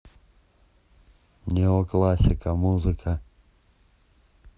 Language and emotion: Russian, neutral